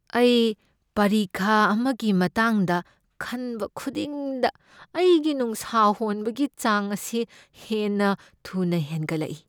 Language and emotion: Manipuri, fearful